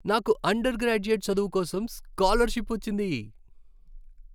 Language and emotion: Telugu, happy